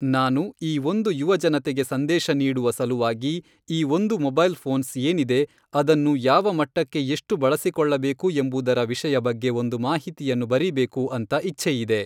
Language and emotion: Kannada, neutral